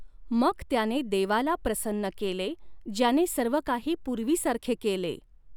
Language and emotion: Marathi, neutral